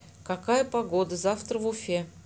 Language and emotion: Russian, neutral